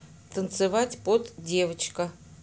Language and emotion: Russian, neutral